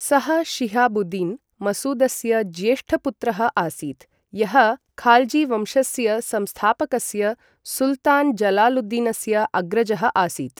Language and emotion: Sanskrit, neutral